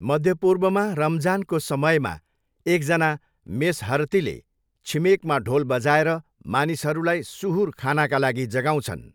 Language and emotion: Nepali, neutral